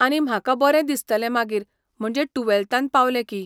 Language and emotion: Goan Konkani, neutral